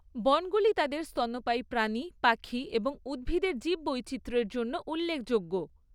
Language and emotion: Bengali, neutral